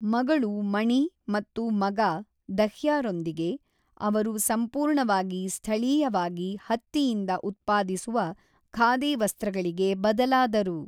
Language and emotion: Kannada, neutral